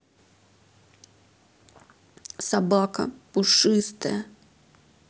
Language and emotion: Russian, sad